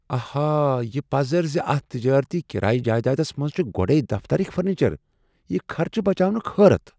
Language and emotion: Kashmiri, surprised